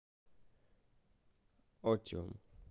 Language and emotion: Russian, neutral